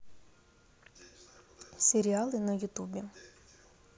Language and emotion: Russian, neutral